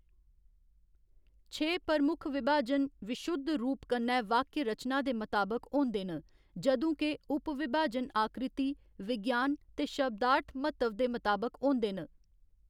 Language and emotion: Dogri, neutral